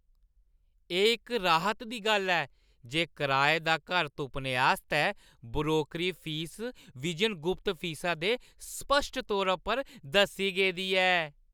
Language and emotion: Dogri, happy